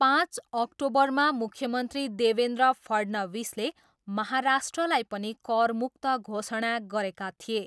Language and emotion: Nepali, neutral